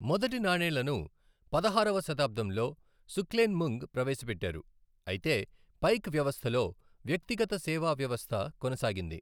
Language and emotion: Telugu, neutral